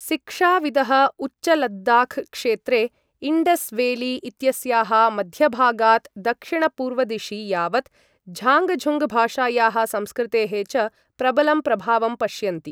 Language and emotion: Sanskrit, neutral